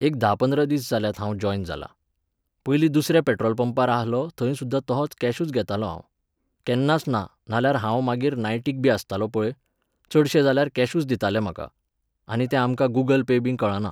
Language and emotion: Goan Konkani, neutral